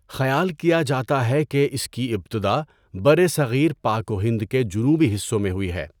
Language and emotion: Urdu, neutral